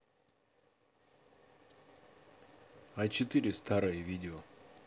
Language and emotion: Russian, neutral